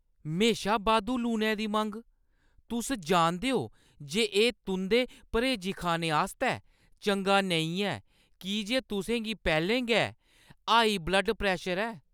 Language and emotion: Dogri, angry